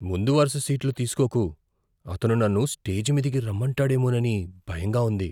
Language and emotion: Telugu, fearful